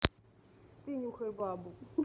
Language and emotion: Russian, neutral